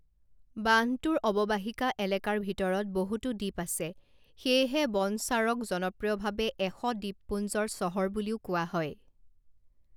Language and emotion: Assamese, neutral